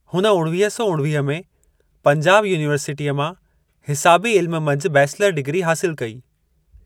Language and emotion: Sindhi, neutral